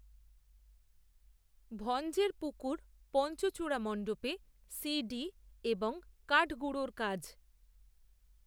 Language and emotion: Bengali, neutral